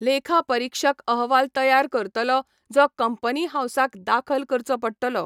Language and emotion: Goan Konkani, neutral